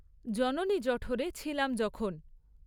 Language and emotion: Bengali, neutral